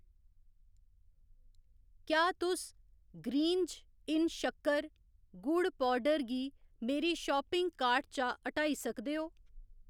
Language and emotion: Dogri, neutral